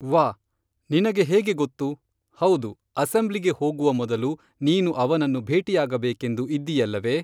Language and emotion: Kannada, neutral